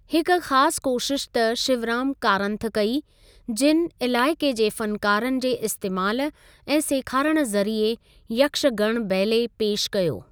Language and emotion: Sindhi, neutral